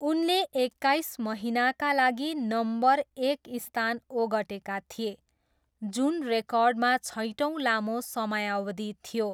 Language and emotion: Nepali, neutral